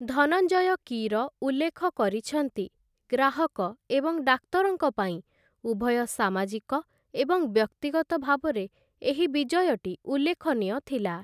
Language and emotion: Odia, neutral